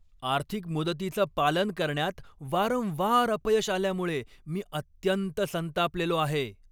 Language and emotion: Marathi, angry